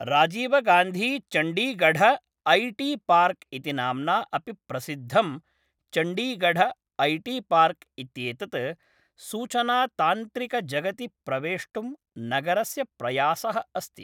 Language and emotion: Sanskrit, neutral